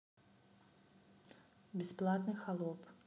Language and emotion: Russian, neutral